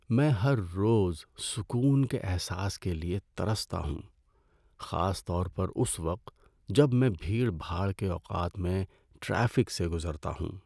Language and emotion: Urdu, sad